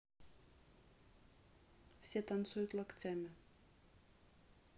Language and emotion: Russian, neutral